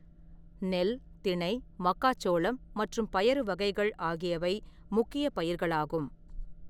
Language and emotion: Tamil, neutral